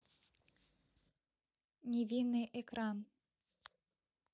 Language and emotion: Russian, neutral